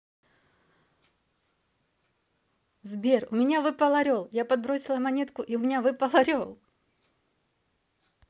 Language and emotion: Russian, positive